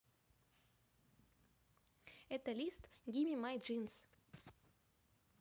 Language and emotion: Russian, positive